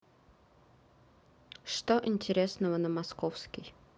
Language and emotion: Russian, neutral